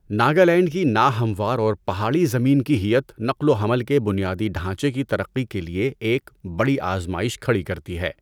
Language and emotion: Urdu, neutral